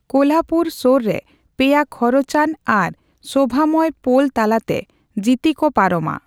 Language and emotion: Santali, neutral